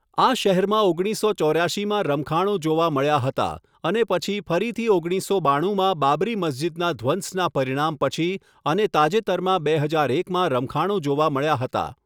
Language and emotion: Gujarati, neutral